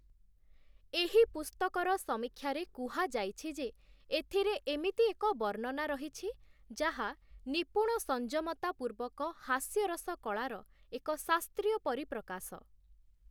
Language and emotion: Odia, neutral